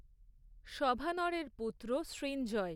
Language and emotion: Bengali, neutral